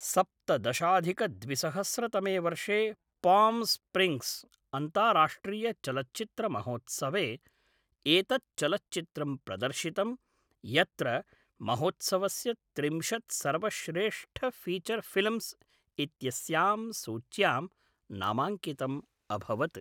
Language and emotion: Sanskrit, neutral